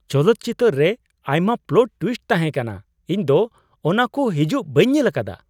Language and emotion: Santali, surprised